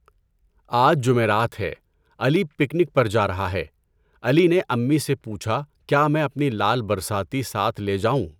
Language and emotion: Urdu, neutral